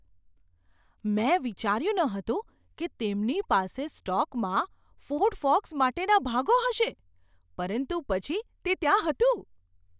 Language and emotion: Gujarati, surprised